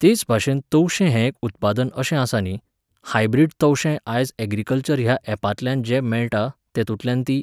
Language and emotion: Goan Konkani, neutral